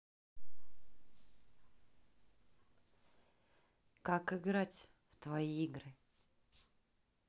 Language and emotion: Russian, neutral